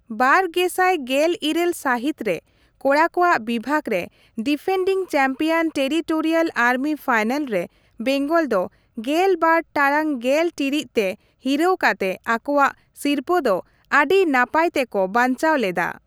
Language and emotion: Santali, neutral